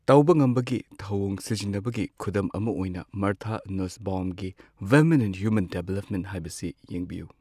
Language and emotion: Manipuri, neutral